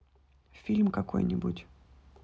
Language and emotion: Russian, neutral